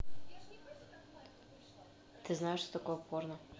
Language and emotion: Russian, neutral